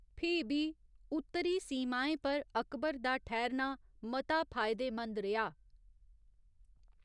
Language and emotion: Dogri, neutral